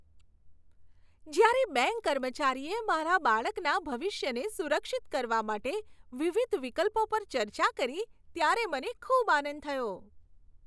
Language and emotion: Gujarati, happy